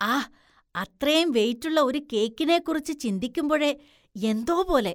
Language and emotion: Malayalam, disgusted